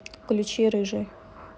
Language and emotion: Russian, neutral